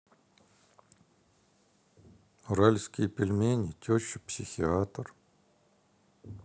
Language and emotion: Russian, sad